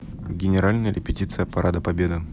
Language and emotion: Russian, neutral